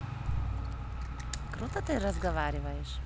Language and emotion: Russian, positive